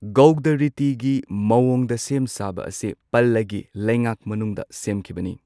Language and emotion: Manipuri, neutral